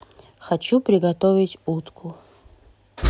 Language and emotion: Russian, neutral